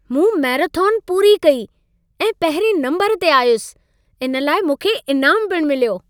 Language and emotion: Sindhi, happy